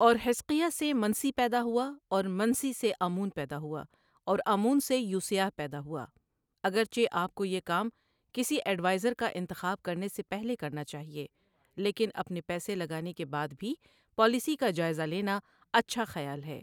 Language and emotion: Urdu, neutral